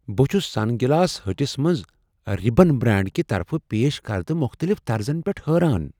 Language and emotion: Kashmiri, surprised